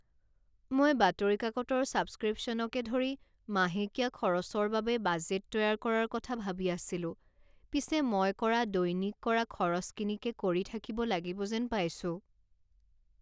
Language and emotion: Assamese, sad